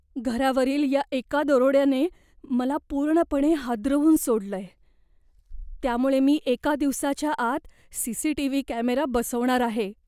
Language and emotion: Marathi, fearful